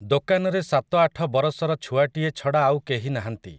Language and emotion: Odia, neutral